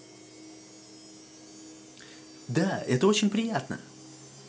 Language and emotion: Russian, positive